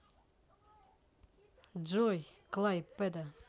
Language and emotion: Russian, neutral